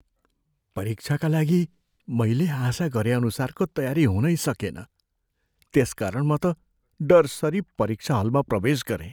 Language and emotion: Nepali, fearful